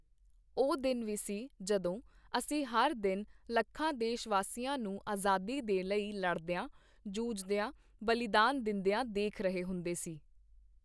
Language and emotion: Punjabi, neutral